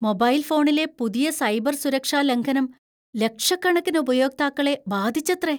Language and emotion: Malayalam, fearful